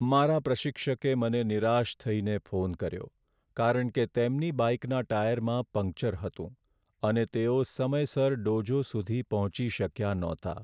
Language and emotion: Gujarati, sad